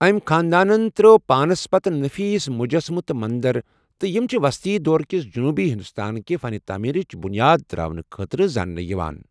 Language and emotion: Kashmiri, neutral